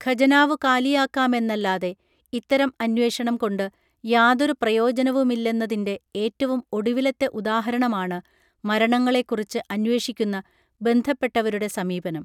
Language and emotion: Malayalam, neutral